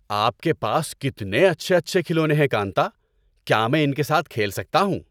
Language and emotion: Urdu, happy